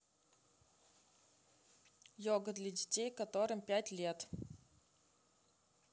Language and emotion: Russian, neutral